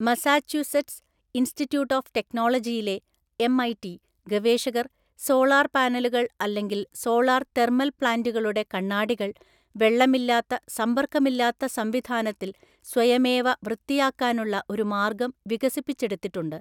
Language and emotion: Malayalam, neutral